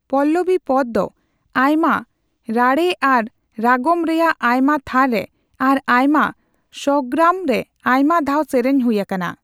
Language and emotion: Santali, neutral